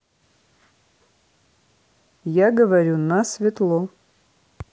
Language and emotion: Russian, neutral